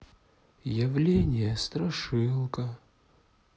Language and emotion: Russian, sad